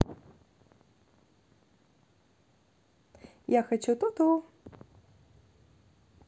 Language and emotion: Russian, positive